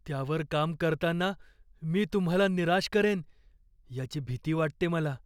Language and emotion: Marathi, fearful